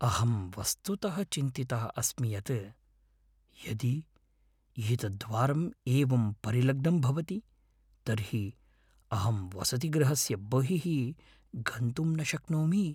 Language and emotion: Sanskrit, fearful